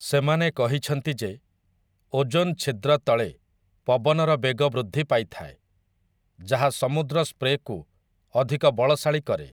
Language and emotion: Odia, neutral